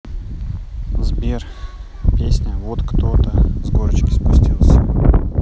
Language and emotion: Russian, neutral